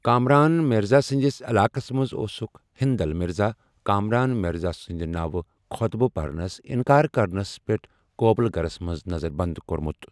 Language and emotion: Kashmiri, neutral